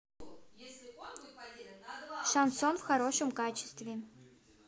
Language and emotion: Russian, neutral